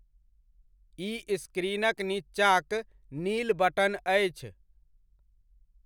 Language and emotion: Maithili, neutral